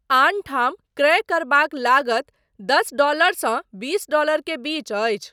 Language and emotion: Maithili, neutral